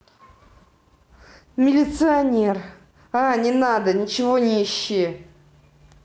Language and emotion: Russian, angry